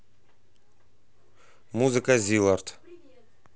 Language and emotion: Russian, neutral